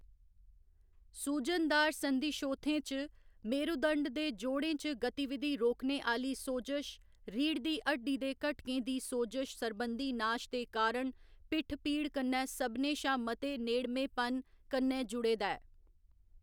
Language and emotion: Dogri, neutral